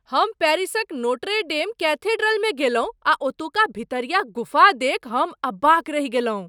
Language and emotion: Maithili, surprised